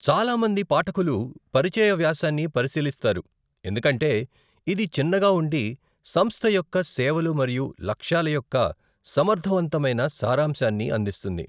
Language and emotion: Telugu, neutral